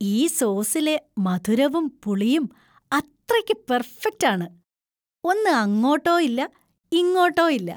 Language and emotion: Malayalam, happy